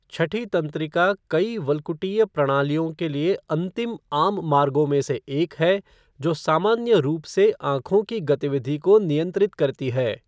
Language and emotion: Hindi, neutral